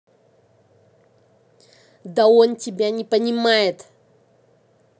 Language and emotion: Russian, angry